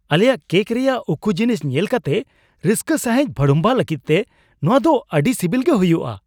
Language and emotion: Santali, surprised